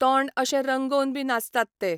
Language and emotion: Goan Konkani, neutral